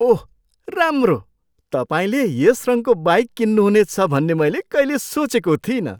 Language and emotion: Nepali, surprised